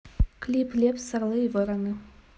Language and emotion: Russian, neutral